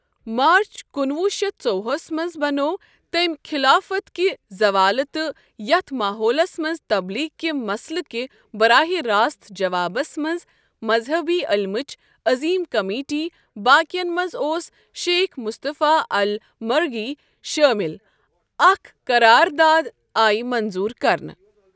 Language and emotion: Kashmiri, neutral